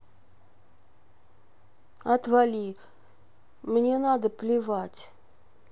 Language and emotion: Russian, sad